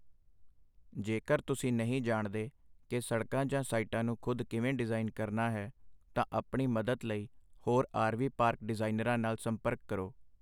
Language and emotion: Punjabi, neutral